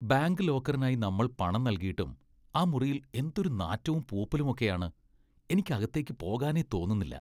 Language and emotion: Malayalam, disgusted